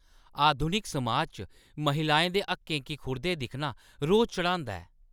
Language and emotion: Dogri, angry